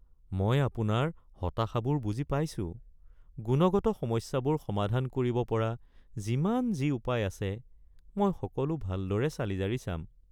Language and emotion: Assamese, sad